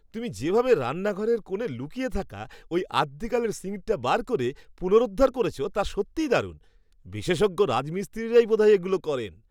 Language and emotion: Bengali, surprised